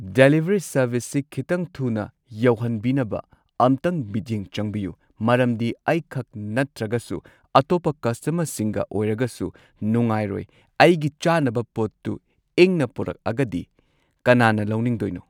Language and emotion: Manipuri, neutral